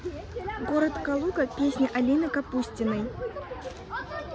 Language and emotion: Russian, neutral